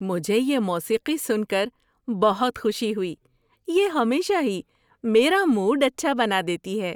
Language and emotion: Urdu, happy